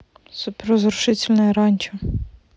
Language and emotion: Russian, neutral